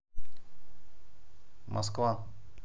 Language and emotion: Russian, neutral